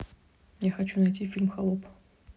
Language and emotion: Russian, neutral